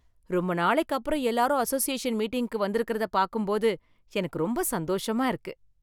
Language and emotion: Tamil, happy